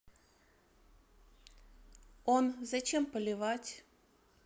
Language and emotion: Russian, neutral